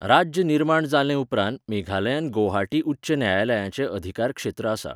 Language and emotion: Goan Konkani, neutral